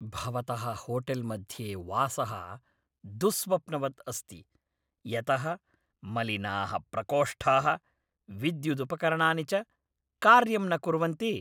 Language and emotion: Sanskrit, angry